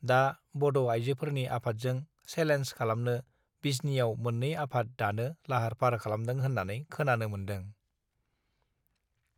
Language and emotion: Bodo, neutral